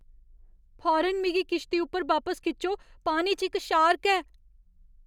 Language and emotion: Dogri, fearful